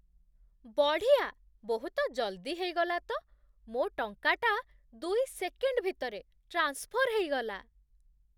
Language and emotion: Odia, surprised